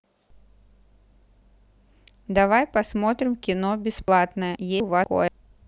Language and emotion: Russian, neutral